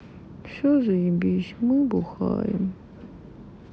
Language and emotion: Russian, sad